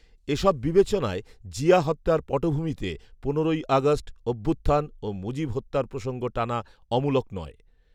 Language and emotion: Bengali, neutral